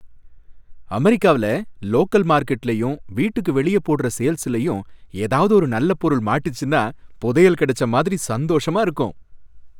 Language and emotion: Tamil, happy